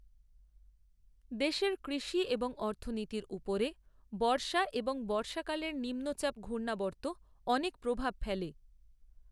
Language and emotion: Bengali, neutral